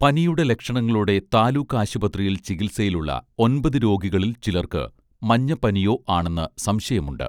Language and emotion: Malayalam, neutral